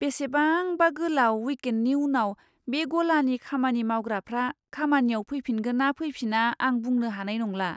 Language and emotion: Bodo, fearful